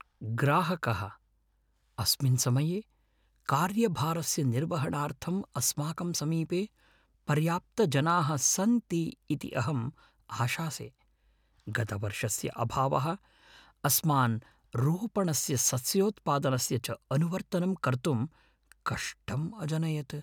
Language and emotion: Sanskrit, fearful